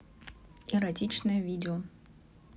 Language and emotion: Russian, neutral